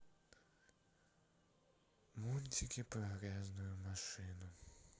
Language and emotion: Russian, sad